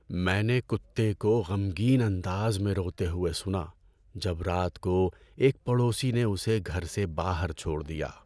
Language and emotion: Urdu, sad